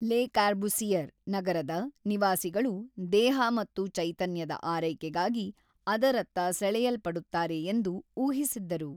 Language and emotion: Kannada, neutral